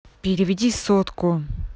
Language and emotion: Russian, angry